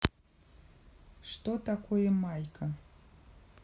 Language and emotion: Russian, neutral